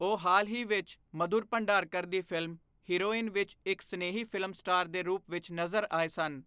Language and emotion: Punjabi, neutral